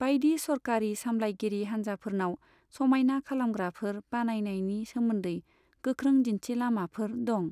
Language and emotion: Bodo, neutral